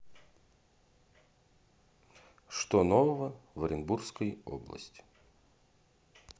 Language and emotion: Russian, neutral